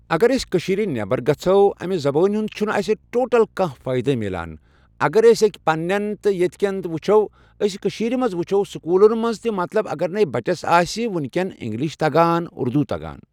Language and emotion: Kashmiri, neutral